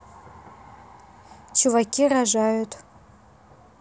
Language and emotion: Russian, neutral